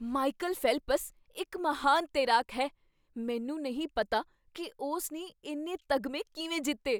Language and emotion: Punjabi, surprised